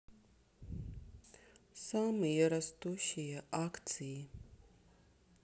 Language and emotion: Russian, sad